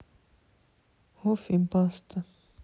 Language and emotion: Russian, sad